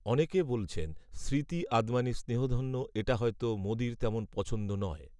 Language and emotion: Bengali, neutral